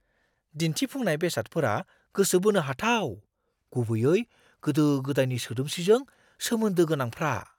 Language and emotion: Bodo, surprised